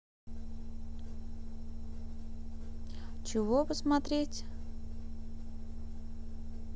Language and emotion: Russian, neutral